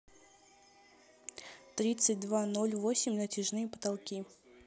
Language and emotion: Russian, neutral